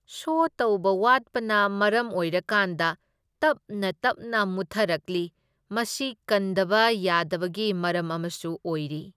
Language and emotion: Manipuri, neutral